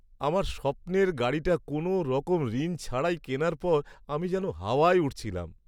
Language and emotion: Bengali, happy